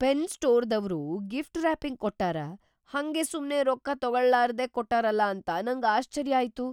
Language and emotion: Kannada, surprised